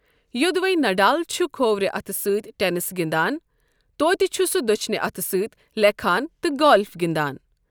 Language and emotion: Kashmiri, neutral